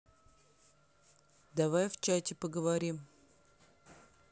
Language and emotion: Russian, neutral